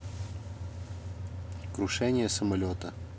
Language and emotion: Russian, neutral